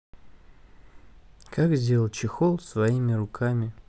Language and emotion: Russian, neutral